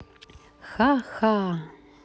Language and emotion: Russian, positive